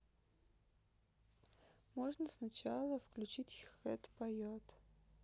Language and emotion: Russian, neutral